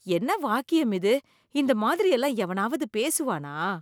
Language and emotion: Tamil, disgusted